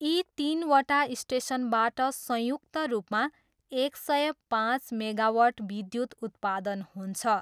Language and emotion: Nepali, neutral